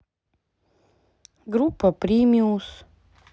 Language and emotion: Russian, neutral